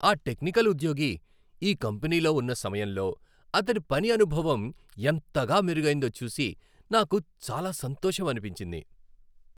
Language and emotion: Telugu, happy